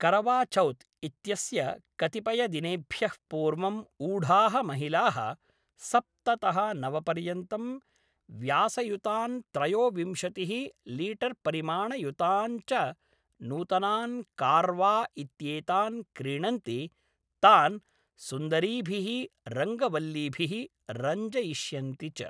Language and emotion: Sanskrit, neutral